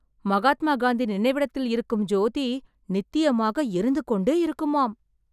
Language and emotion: Tamil, surprised